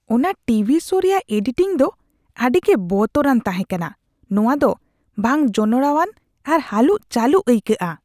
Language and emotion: Santali, disgusted